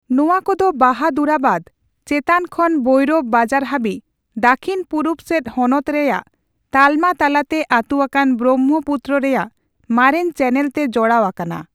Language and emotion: Santali, neutral